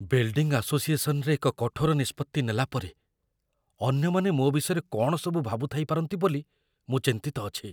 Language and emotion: Odia, fearful